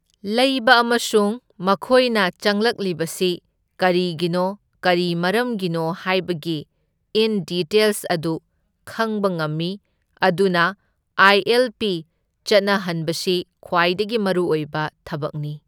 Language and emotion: Manipuri, neutral